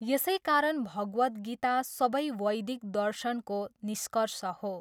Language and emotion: Nepali, neutral